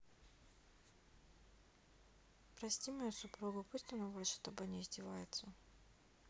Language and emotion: Russian, neutral